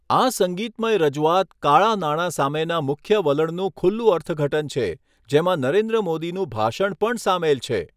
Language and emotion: Gujarati, neutral